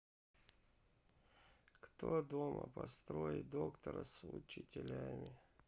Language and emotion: Russian, sad